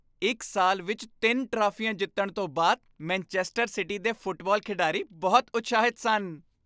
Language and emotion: Punjabi, happy